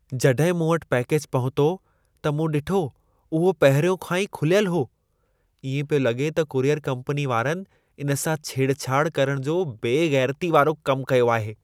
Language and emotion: Sindhi, disgusted